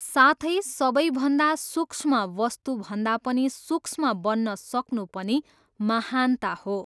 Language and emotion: Nepali, neutral